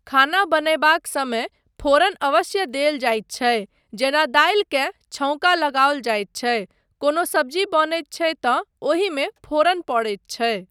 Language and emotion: Maithili, neutral